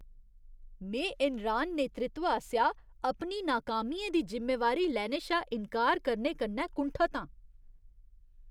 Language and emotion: Dogri, disgusted